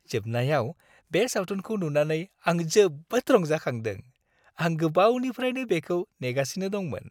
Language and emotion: Bodo, happy